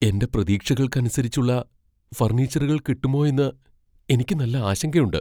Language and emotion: Malayalam, fearful